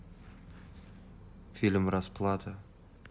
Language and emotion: Russian, neutral